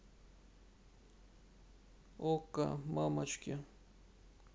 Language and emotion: Russian, sad